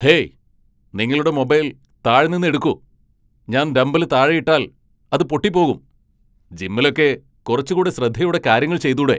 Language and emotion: Malayalam, angry